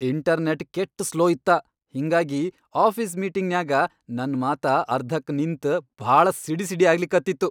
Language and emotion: Kannada, angry